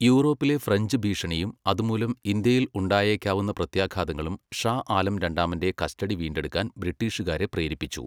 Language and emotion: Malayalam, neutral